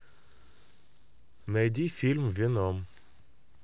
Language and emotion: Russian, neutral